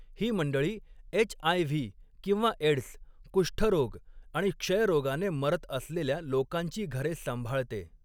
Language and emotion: Marathi, neutral